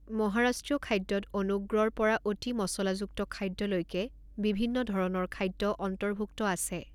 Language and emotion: Assamese, neutral